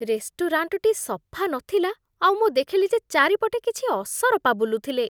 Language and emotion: Odia, disgusted